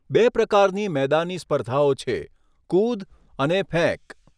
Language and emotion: Gujarati, neutral